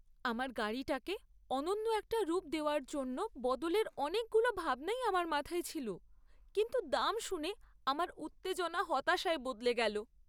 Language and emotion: Bengali, sad